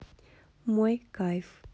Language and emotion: Russian, neutral